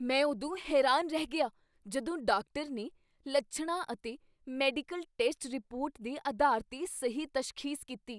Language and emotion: Punjabi, surprised